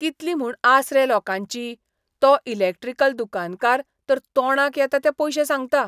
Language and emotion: Goan Konkani, disgusted